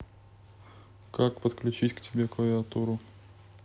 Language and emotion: Russian, neutral